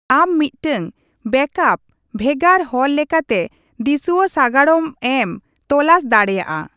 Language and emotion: Santali, neutral